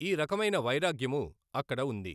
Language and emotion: Telugu, neutral